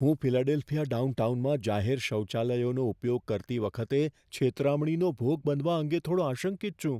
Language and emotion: Gujarati, fearful